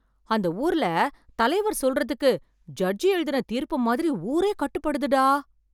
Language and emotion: Tamil, surprised